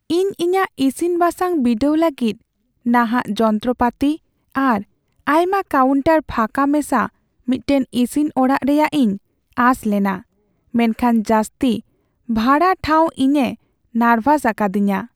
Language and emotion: Santali, sad